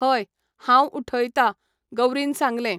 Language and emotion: Goan Konkani, neutral